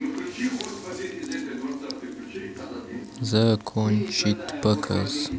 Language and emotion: Russian, neutral